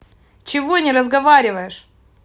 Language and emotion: Russian, angry